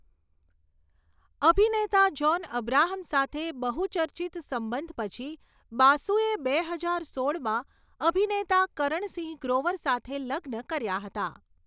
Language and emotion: Gujarati, neutral